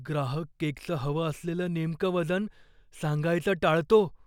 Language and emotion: Marathi, fearful